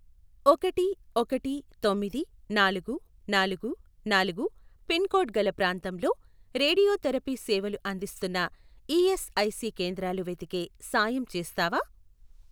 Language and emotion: Telugu, neutral